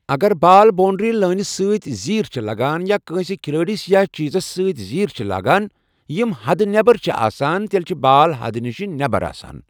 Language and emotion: Kashmiri, neutral